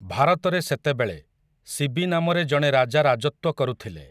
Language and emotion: Odia, neutral